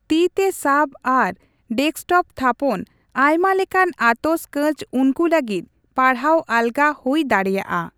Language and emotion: Santali, neutral